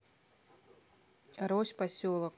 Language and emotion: Russian, neutral